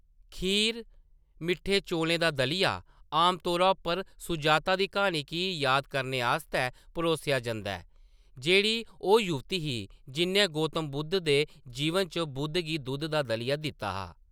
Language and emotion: Dogri, neutral